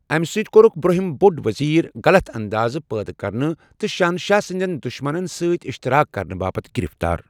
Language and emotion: Kashmiri, neutral